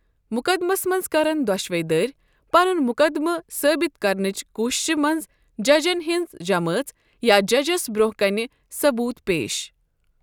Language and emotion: Kashmiri, neutral